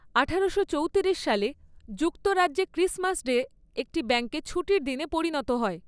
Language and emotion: Bengali, neutral